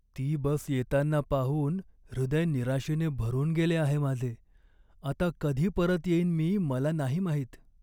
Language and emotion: Marathi, sad